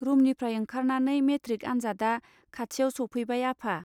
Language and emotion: Bodo, neutral